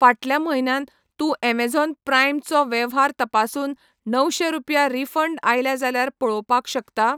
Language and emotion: Goan Konkani, neutral